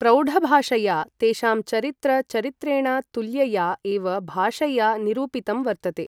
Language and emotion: Sanskrit, neutral